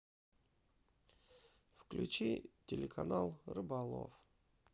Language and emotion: Russian, sad